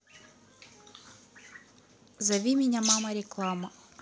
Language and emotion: Russian, neutral